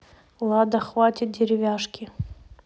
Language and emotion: Russian, neutral